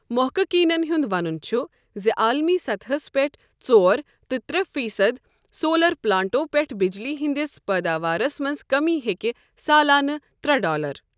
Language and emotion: Kashmiri, neutral